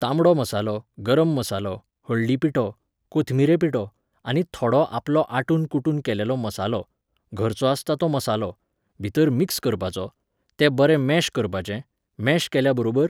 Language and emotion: Goan Konkani, neutral